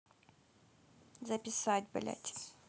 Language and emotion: Russian, neutral